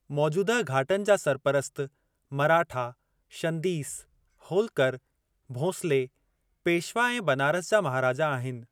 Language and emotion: Sindhi, neutral